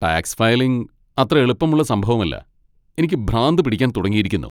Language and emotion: Malayalam, angry